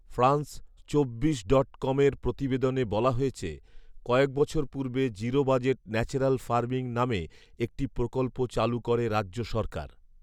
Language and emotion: Bengali, neutral